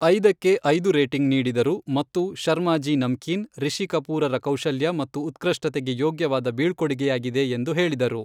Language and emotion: Kannada, neutral